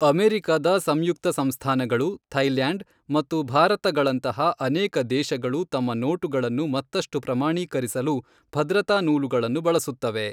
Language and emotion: Kannada, neutral